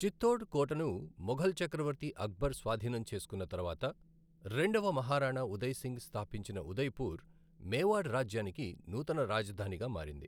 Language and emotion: Telugu, neutral